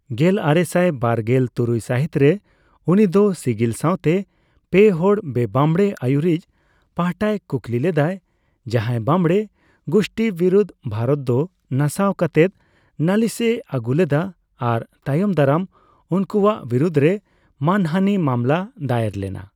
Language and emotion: Santali, neutral